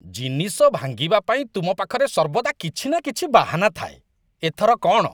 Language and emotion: Odia, disgusted